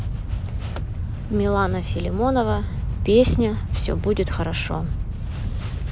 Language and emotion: Russian, neutral